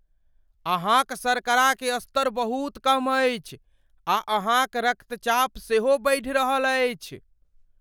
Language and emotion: Maithili, fearful